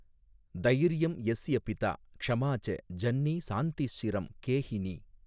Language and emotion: Tamil, neutral